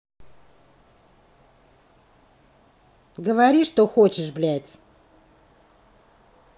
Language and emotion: Russian, angry